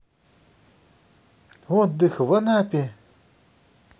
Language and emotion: Russian, positive